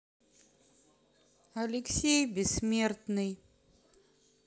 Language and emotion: Russian, sad